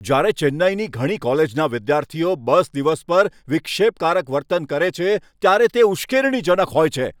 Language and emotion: Gujarati, angry